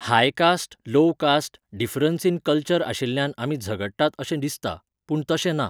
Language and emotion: Goan Konkani, neutral